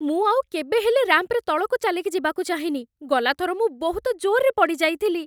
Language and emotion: Odia, fearful